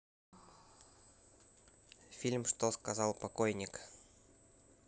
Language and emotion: Russian, neutral